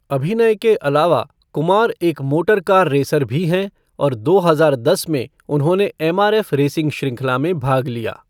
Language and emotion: Hindi, neutral